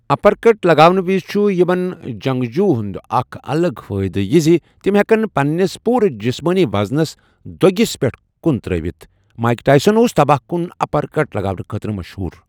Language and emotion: Kashmiri, neutral